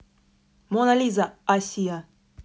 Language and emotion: Russian, neutral